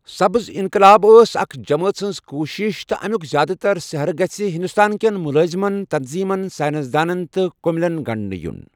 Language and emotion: Kashmiri, neutral